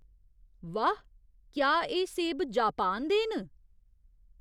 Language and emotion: Dogri, surprised